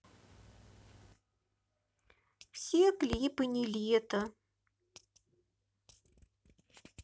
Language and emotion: Russian, sad